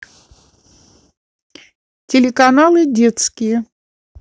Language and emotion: Russian, neutral